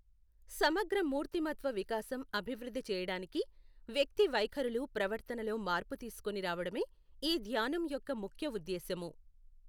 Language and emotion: Telugu, neutral